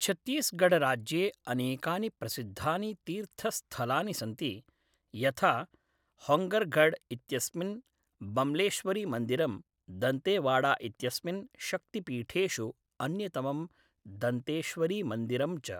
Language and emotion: Sanskrit, neutral